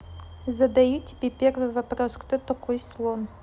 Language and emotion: Russian, neutral